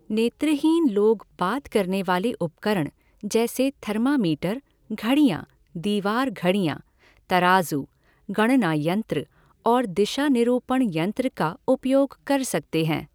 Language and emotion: Hindi, neutral